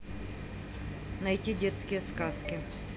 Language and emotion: Russian, neutral